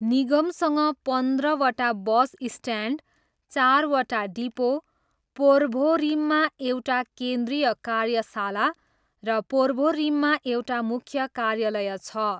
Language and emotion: Nepali, neutral